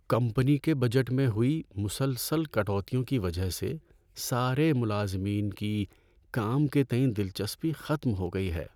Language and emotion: Urdu, sad